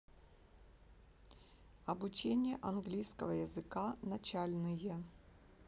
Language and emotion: Russian, neutral